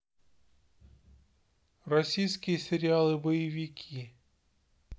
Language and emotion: Russian, neutral